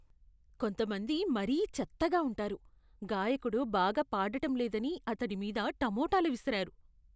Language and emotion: Telugu, disgusted